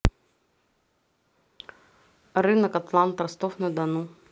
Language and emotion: Russian, neutral